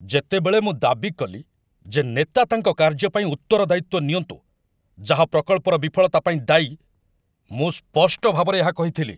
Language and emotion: Odia, angry